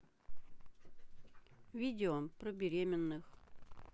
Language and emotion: Russian, neutral